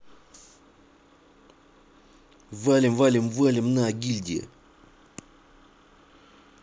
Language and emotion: Russian, neutral